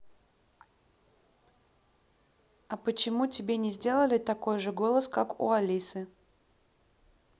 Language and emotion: Russian, neutral